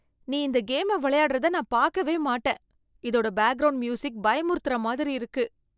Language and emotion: Tamil, fearful